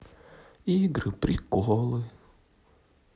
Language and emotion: Russian, sad